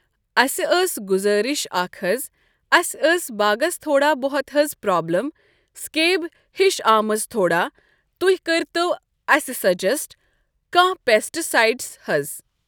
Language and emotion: Kashmiri, neutral